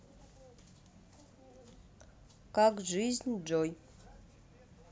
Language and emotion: Russian, neutral